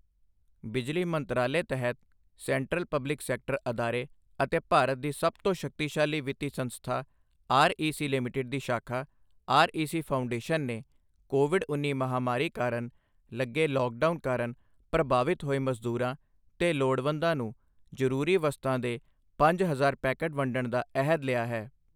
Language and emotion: Punjabi, neutral